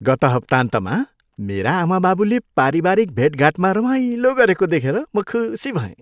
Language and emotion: Nepali, happy